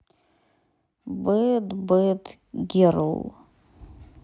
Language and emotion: Russian, neutral